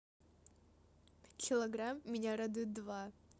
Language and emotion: Russian, positive